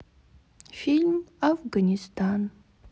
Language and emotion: Russian, sad